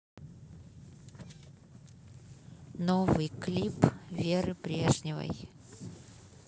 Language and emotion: Russian, neutral